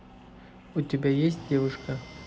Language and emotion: Russian, neutral